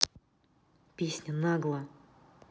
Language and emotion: Russian, angry